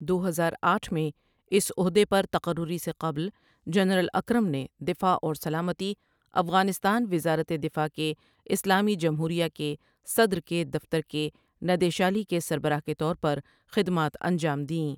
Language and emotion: Urdu, neutral